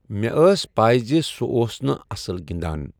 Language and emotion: Kashmiri, neutral